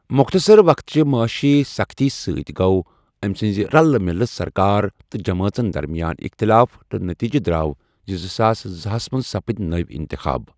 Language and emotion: Kashmiri, neutral